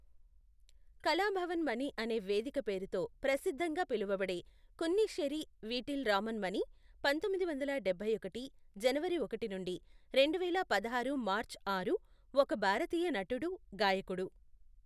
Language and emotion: Telugu, neutral